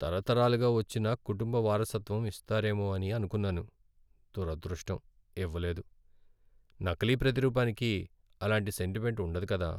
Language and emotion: Telugu, sad